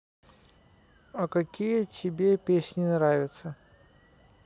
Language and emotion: Russian, neutral